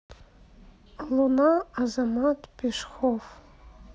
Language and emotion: Russian, neutral